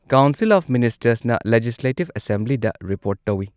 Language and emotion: Manipuri, neutral